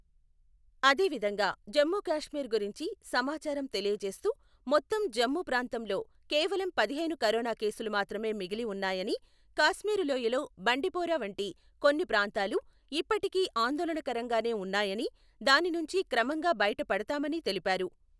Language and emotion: Telugu, neutral